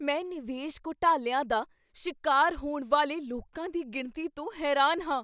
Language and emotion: Punjabi, surprised